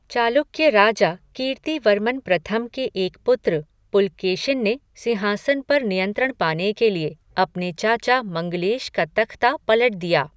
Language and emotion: Hindi, neutral